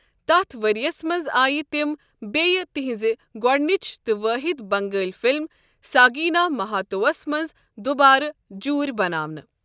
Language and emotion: Kashmiri, neutral